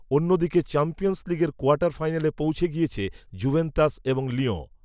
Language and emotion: Bengali, neutral